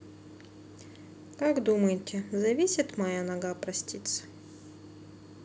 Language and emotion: Russian, sad